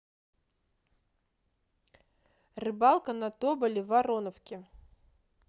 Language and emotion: Russian, neutral